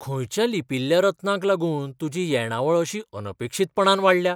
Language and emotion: Goan Konkani, surprised